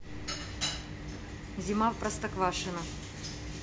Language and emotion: Russian, neutral